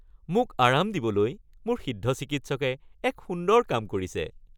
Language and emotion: Assamese, happy